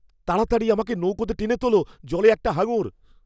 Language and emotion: Bengali, fearful